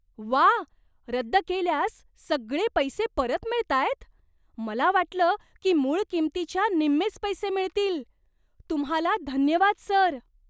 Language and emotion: Marathi, surprised